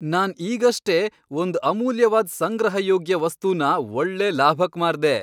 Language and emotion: Kannada, happy